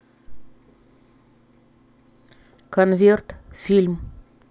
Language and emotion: Russian, neutral